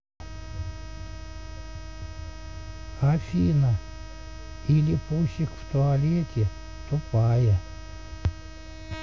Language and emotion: Russian, neutral